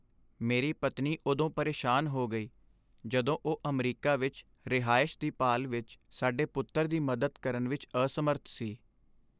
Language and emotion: Punjabi, sad